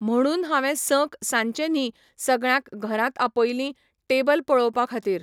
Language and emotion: Goan Konkani, neutral